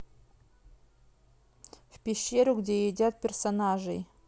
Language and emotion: Russian, neutral